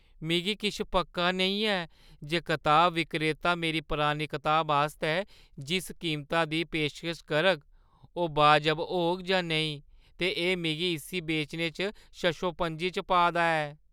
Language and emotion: Dogri, fearful